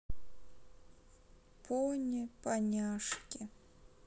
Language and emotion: Russian, sad